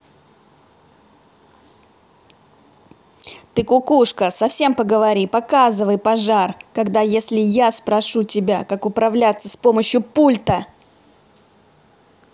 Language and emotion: Russian, angry